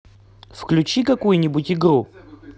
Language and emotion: Russian, positive